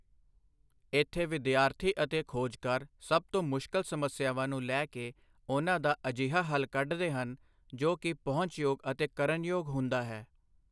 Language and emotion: Punjabi, neutral